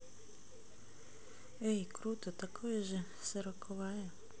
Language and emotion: Russian, neutral